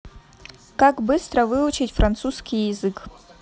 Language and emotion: Russian, neutral